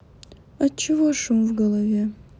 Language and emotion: Russian, sad